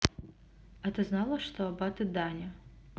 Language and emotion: Russian, neutral